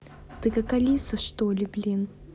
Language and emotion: Russian, angry